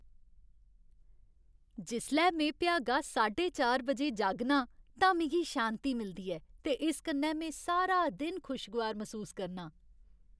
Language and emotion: Dogri, happy